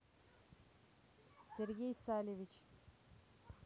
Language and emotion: Russian, neutral